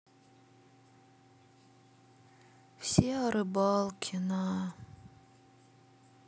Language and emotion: Russian, sad